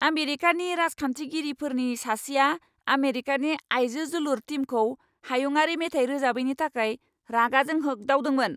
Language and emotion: Bodo, angry